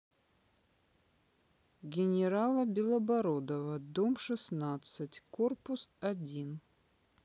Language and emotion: Russian, neutral